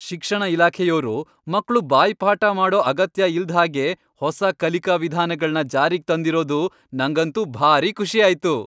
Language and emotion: Kannada, happy